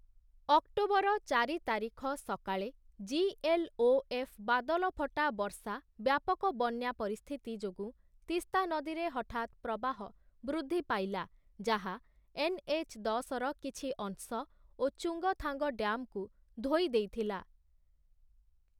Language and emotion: Odia, neutral